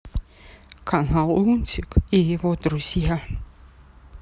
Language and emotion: Russian, sad